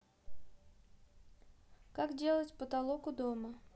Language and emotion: Russian, neutral